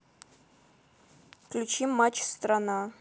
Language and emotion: Russian, neutral